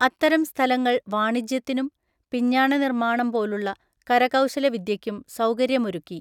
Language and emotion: Malayalam, neutral